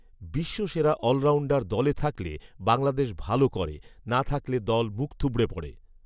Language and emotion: Bengali, neutral